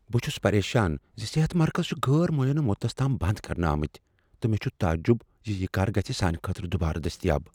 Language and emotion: Kashmiri, fearful